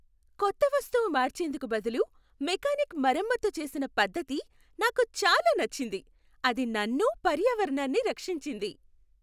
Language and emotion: Telugu, happy